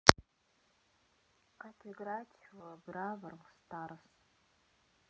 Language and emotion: Russian, neutral